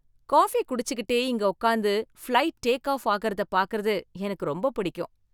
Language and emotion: Tamil, happy